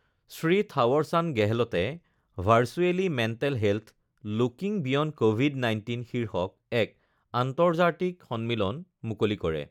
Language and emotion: Assamese, neutral